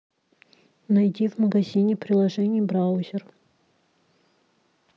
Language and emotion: Russian, neutral